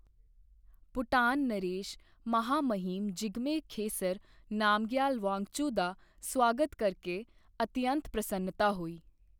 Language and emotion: Punjabi, neutral